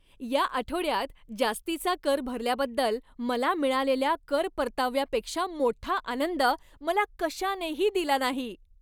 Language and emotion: Marathi, happy